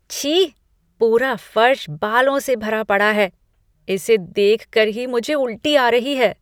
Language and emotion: Hindi, disgusted